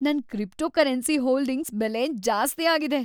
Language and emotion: Kannada, happy